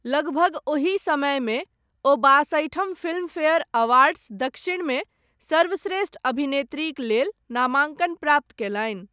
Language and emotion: Maithili, neutral